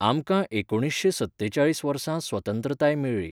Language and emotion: Goan Konkani, neutral